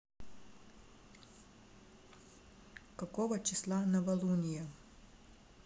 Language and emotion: Russian, neutral